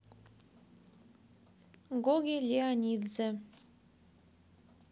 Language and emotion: Russian, neutral